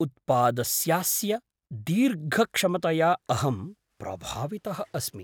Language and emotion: Sanskrit, surprised